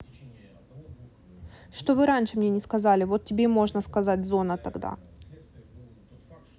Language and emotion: Russian, angry